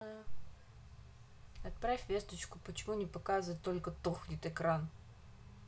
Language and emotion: Russian, neutral